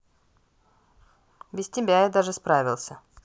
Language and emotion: Russian, neutral